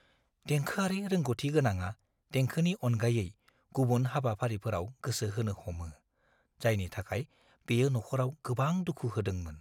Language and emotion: Bodo, fearful